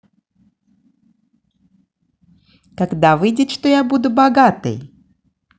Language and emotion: Russian, positive